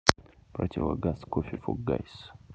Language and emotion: Russian, neutral